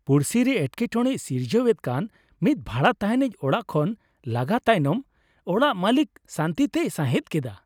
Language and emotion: Santali, happy